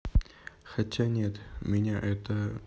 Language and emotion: Russian, neutral